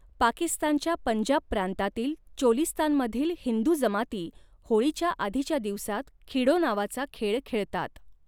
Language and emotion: Marathi, neutral